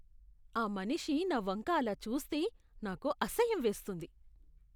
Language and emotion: Telugu, disgusted